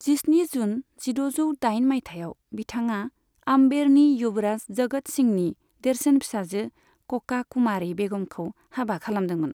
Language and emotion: Bodo, neutral